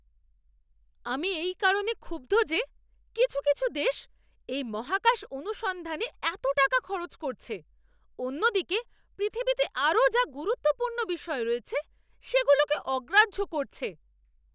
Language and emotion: Bengali, angry